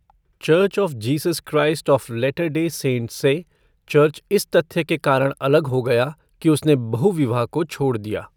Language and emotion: Hindi, neutral